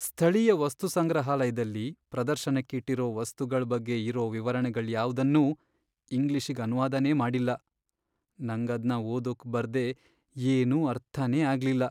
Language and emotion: Kannada, sad